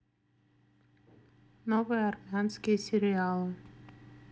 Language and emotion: Russian, neutral